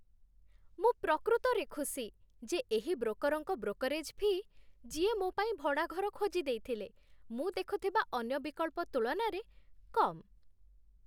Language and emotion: Odia, happy